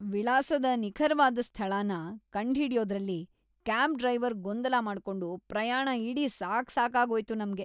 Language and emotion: Kannada, disgusted